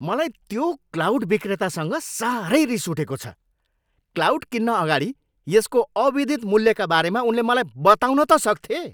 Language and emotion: Nepali, angry